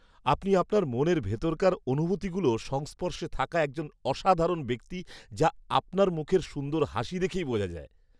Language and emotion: Bengali, happy